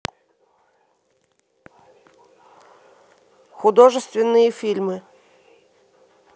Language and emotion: Russian, neutral